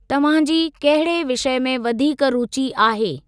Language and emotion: Sindhi, neutral